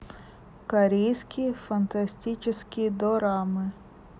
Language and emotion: Russian, neutral